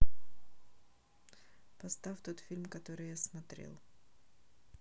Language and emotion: Russian, neutral